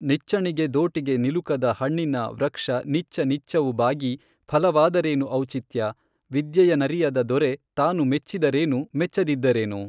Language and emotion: Kannada, neutral